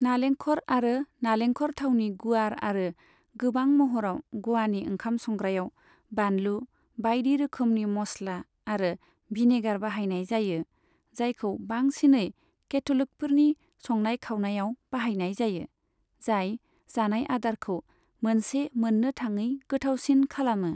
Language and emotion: Bodo, neutral